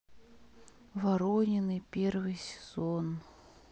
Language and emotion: Russian, sad